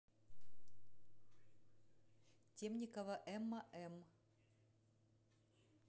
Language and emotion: Russian, neutral